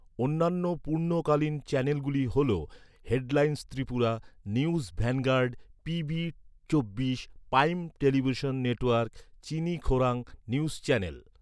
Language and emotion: Bengali, neutral